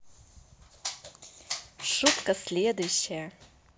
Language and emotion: Russian, positive